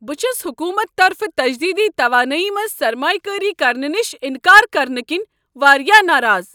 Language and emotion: Kashmiri, angry